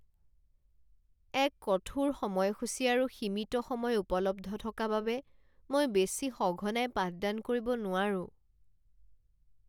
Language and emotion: Assamese, sad